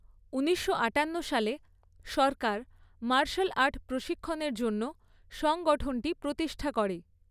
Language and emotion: Bengali, neutral